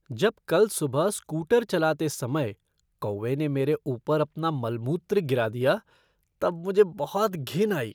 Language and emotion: Hindi, disgusted